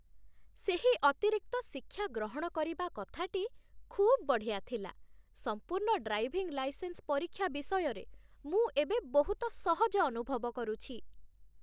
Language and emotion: Odia, happy